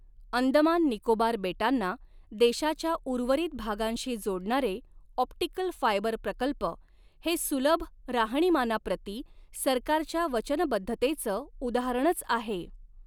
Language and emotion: Marathi, neutral